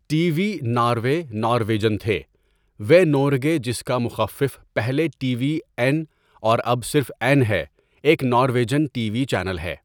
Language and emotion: Urdu, neutral